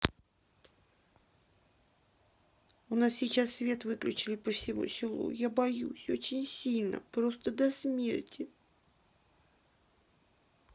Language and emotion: Russian, sad